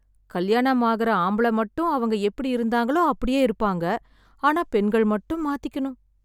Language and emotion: Tamil, sad